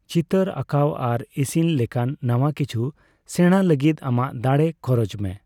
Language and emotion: Santali, neutral